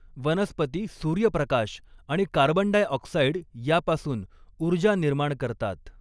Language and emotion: Marathi, neutral